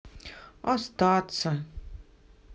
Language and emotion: Russian, sad